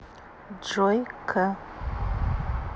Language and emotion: Russian, neutral